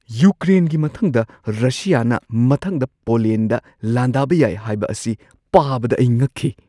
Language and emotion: Manipuri, surprised